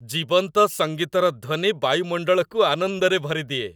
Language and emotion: Odia, happy